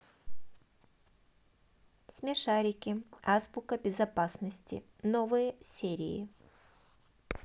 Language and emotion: Russian, neutral